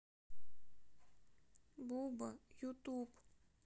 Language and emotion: Russian, sad